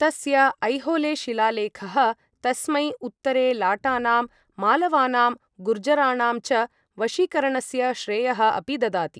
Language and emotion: Sanskrit, neutral